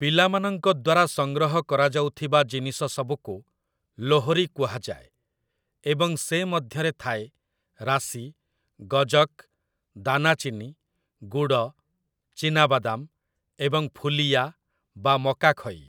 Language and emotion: Odia, neutral